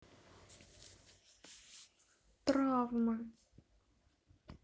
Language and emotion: Russian, sad